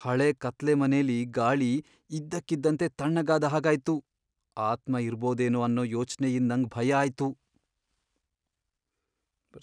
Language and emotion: Kannada, fearful